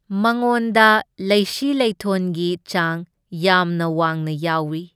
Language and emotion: Manipuri, neutral